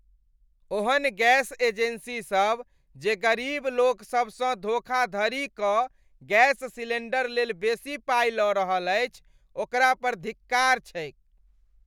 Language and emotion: Maithili, disgusted